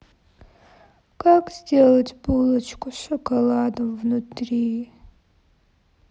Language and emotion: Russian, sad